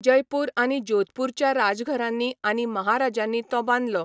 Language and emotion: Goan Konkani, neutral